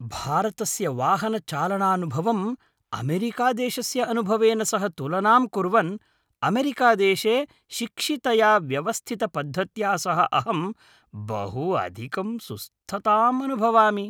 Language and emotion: Sanskrit, happy